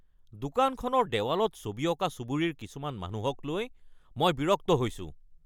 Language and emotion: Assamese, angry